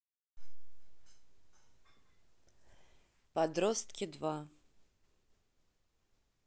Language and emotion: Russian, neutral